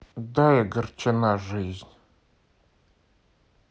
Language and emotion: Russian, sad